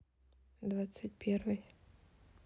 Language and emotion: Russian, neutral